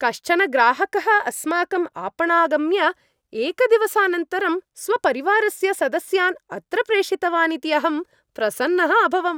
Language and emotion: Sanskrit, happy